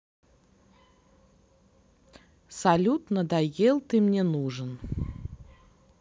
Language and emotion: Russian, neutral